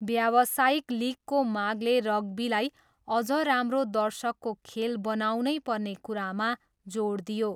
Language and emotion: Nepali, neutral